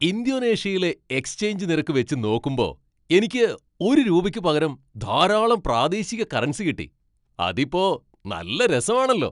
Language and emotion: Malayalam, happy